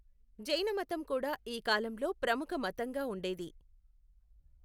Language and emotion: Telugu, neutral